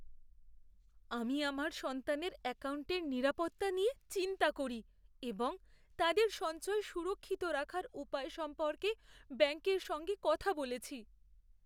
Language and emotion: Bengali, fearful